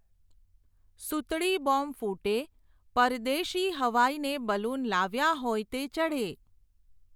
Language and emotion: Gujarati, neutral